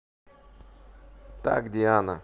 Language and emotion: Russian, neutral